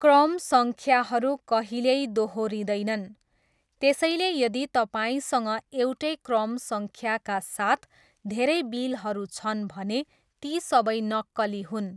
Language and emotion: Nepali, neutral